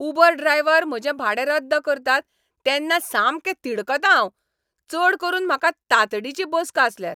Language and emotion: Goan Konkani, angry